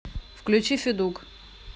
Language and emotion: Russian, neutral